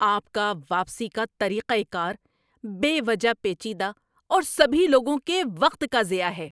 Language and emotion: Urdu, angry